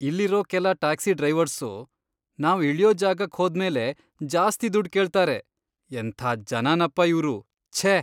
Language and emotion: Kannada, disgusted